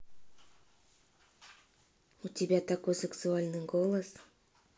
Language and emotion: Russian, neutral